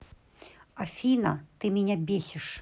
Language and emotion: Russian, angry